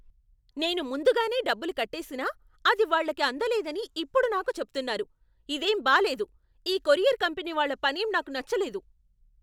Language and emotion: Telugu, angry